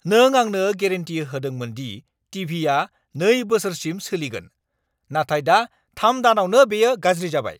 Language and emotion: Bodo, angry